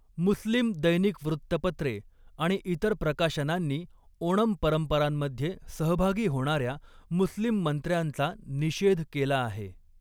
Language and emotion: Marathi, neutral